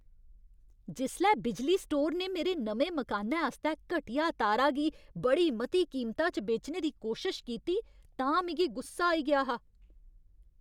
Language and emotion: Dogri, angry